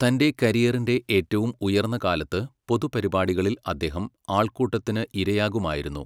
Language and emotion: Malayalam, neutral